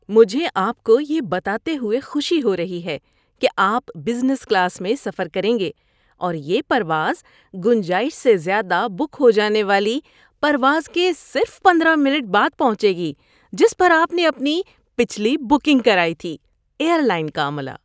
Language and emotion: Urdu, happy